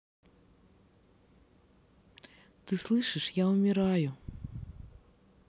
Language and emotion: Russian, sad